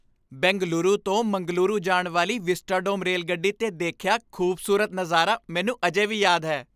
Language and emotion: Punjabi, happy